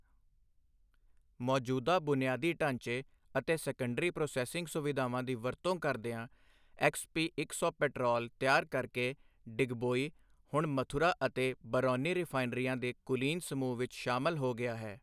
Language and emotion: Punjabi, neutral